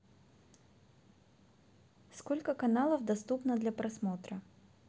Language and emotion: Russian, neutral